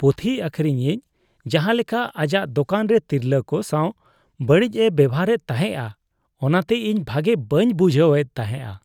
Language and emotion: Santali, disgusted